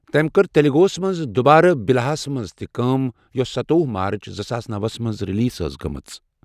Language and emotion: Kashmiri, neutral